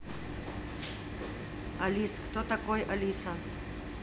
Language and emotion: Russian, neutral